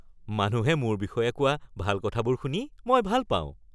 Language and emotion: Assamese, happy